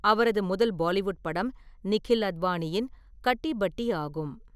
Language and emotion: Tamil, neutral